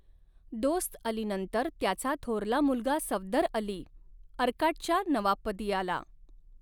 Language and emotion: Marathi, neutral